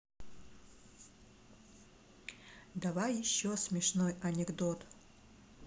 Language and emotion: Russian, neutral